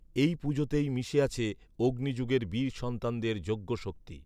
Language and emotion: Bengali, neutral